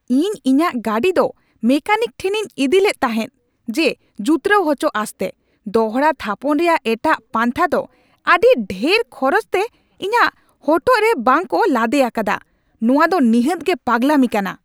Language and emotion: Santali, angry